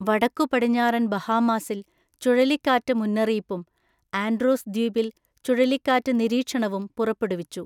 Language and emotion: Malayalam, neutral